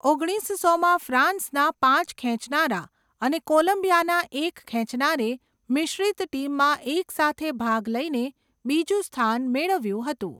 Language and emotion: Gujarati, neutral